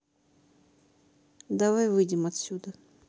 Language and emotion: Russian, neutral